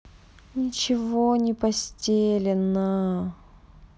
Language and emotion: Russian, sad